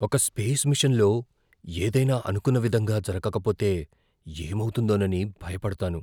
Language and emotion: Telugu, fearful